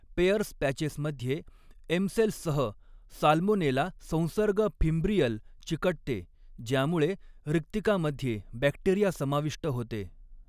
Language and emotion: Marathi, neutral